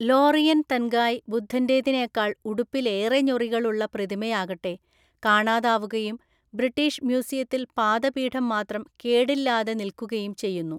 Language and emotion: Malayalam, neutral